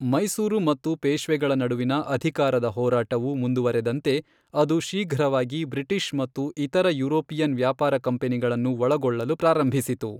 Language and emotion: Kannada, neutral